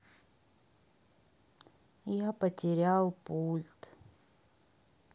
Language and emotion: Russian, sad